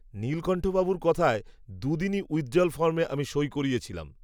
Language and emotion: Bengali, neutral